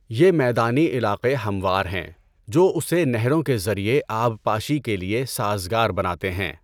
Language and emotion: Urdu, neutral